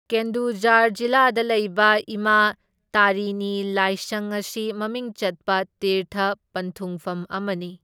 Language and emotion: Manipuri, neutral